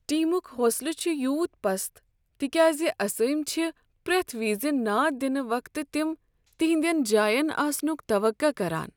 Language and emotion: Kashmiri, sad